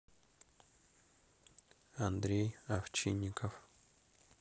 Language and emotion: Russian, neutral